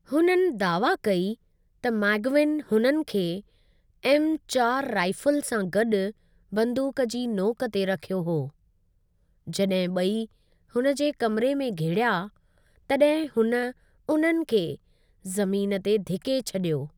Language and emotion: Sindhi, neutral